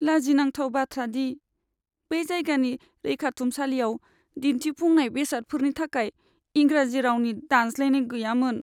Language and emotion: Bodo, sad